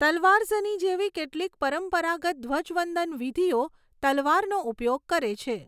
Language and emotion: Gujarati, neutral